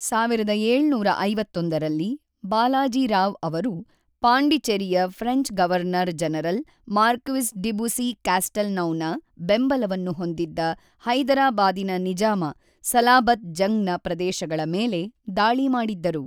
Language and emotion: Kannada, neutral